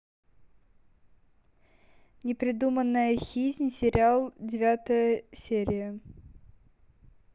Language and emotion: Russian, neutral